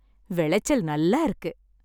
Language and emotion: Tamil, happy